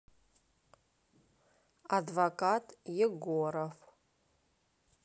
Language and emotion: Russian, neutral